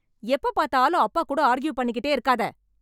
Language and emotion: Tamil, angry